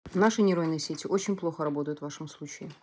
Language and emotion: Russian, neutral